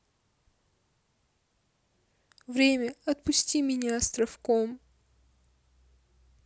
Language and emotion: Russian, sad